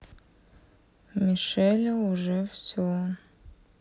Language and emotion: Russian, sad